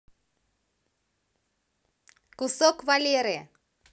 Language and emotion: Russian, positive